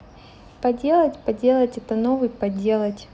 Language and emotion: Russian, neutral